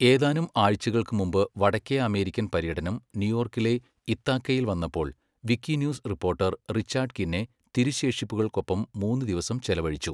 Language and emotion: Malayalam, neutral